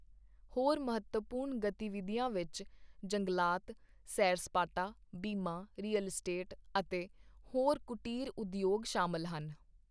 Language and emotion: Punjabi, neutral